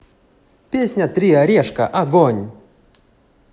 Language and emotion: Russian, positive